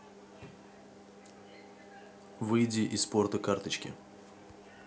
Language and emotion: Russian, neutral